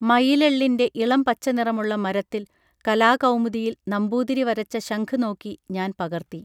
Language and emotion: Malayalam, neutral